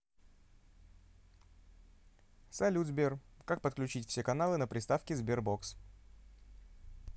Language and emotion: Russian, neutral